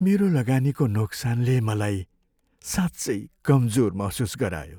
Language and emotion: Nepali, sad